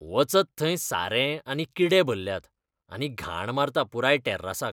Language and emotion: Goan Konkani, disgusted